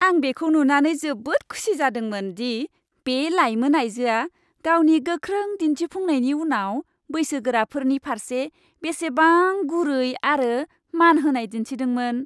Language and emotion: Bodo, happy